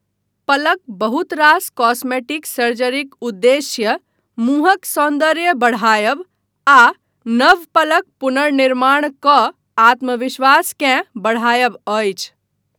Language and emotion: Maithili, neutral